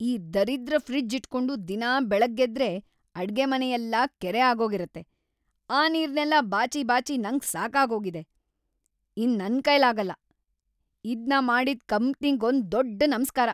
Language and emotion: Kannada, angry